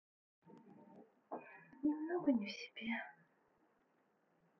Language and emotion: Russian, sad